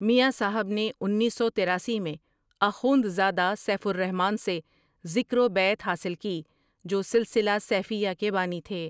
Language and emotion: Urdu, neutral